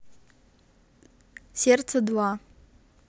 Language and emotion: Russian, positive